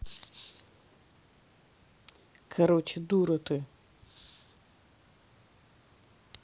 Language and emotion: Russian, angry